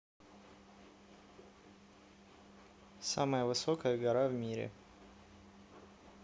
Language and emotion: Russian, neutral